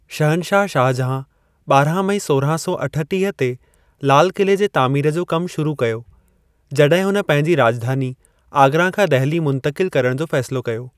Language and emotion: Sindhi, neutral